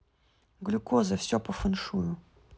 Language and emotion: Russian, neutral